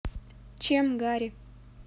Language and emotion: Russian, neutral